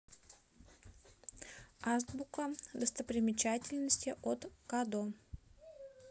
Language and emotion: Russian, neutral